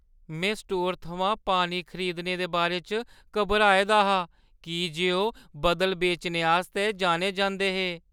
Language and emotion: Dogri, fearful